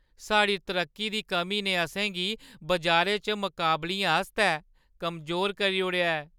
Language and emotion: Dogri, sad